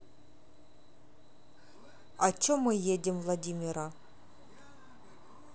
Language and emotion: Russian, neutral